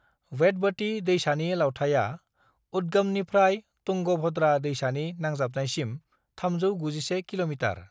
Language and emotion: Bodo, neutral